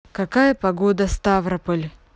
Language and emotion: Russian, neutral